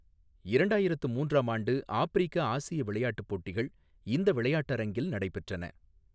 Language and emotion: Tamil, neutral